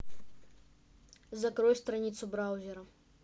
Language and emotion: Russian, neutral